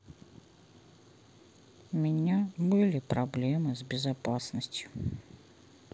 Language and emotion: Russian, sad